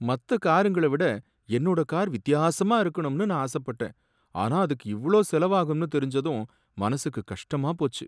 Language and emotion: Tamil, sad